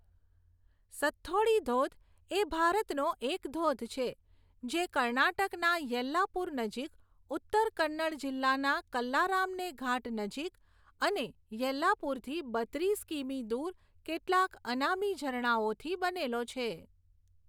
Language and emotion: Gujarati, neutral